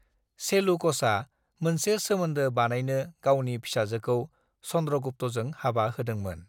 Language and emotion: Bodo, neutral